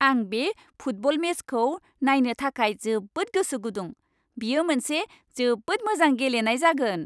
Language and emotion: Bodo, happy